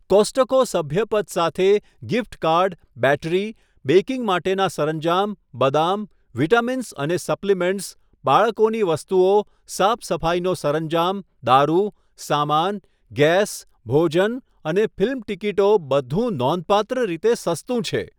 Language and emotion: Gujarati, neutral